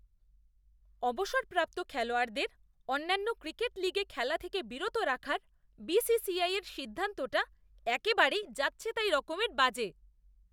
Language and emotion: Bengali, disgusted